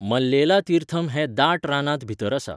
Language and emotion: Goan Konkani, neutral